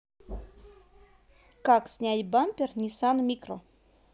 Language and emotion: Russian, positive